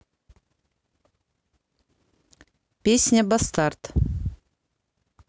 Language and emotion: Russian, neutral